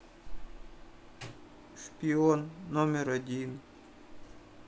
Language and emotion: Russian, sad